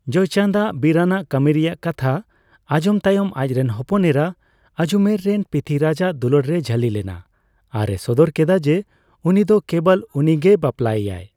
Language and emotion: Santali, neutral